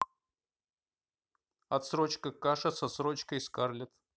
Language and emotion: Russian, neutral